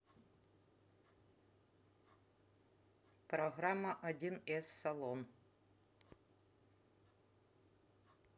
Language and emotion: Russian, neutral